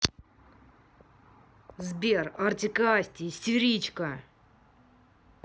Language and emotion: Russian, angry